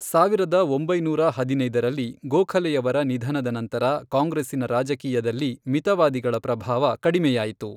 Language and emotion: Kannada, neutral